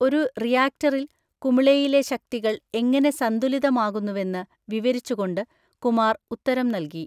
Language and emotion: Malayalam, neutral